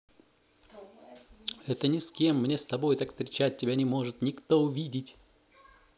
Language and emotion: Russian, positive